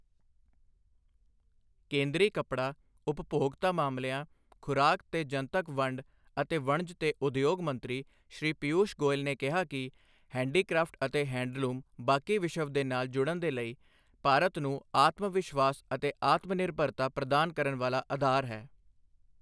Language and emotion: Punjabi, neutral